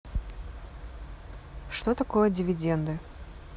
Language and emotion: Russian, neutral